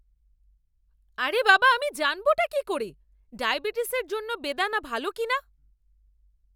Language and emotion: Bengali, angry